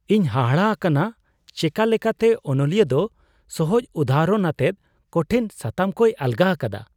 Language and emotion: Santali, surprised